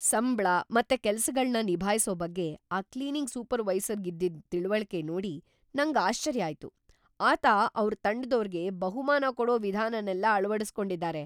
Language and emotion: Kannada, surprised